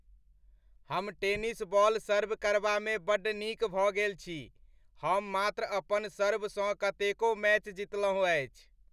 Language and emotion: Maithili, happy